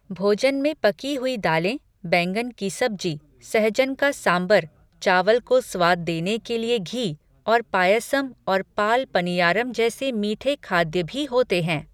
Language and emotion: Hindi, neutral